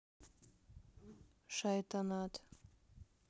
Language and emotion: Russian, neutral